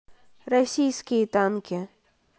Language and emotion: Russian, neutral